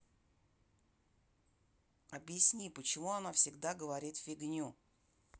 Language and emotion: Russian, neutral